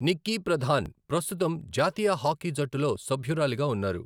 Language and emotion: Telugu, neutral